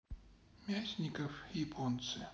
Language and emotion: Russian, sad